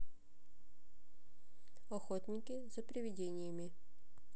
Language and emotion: Russian, neutral